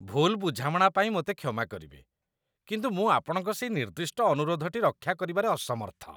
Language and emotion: Odia, disgusted